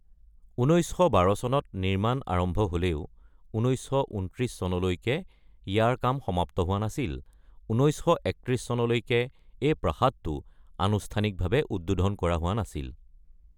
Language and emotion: Assamese, neutral